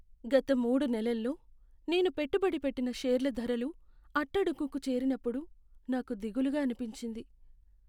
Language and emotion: Telugu, sad